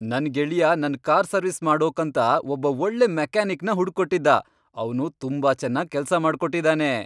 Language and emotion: Kannada, happy